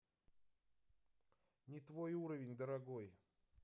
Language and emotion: Russian, neutral